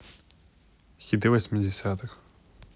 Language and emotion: Russian, neutral